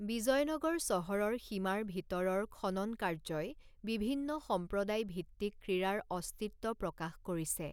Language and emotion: Assamese, neutral